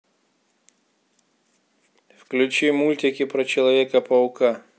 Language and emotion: Russian, neutral